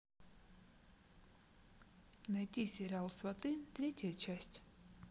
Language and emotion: Russian, neutral